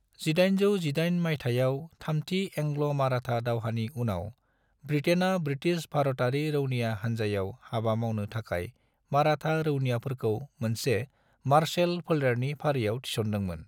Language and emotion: Bodo, neutral